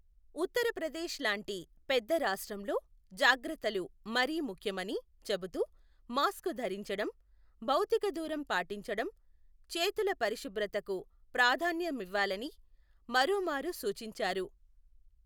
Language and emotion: Telugu, neutral